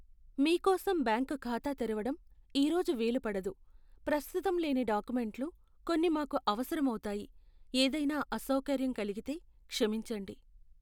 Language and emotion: Telugu, sad